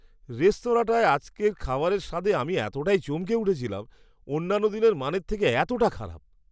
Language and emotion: Bengali, disgusted